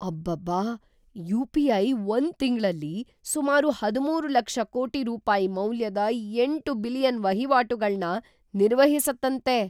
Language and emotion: Kannada, surprised